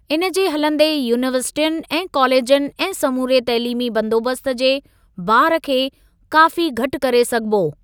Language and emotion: Sindhi, neutral